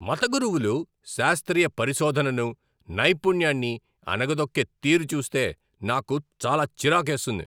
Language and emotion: Telugu, angry